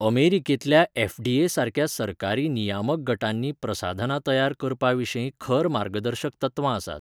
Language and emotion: Goan Konkani, neutral